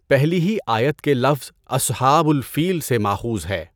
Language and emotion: Urdu, neutral